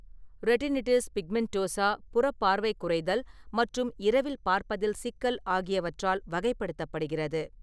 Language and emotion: Tamil, neutral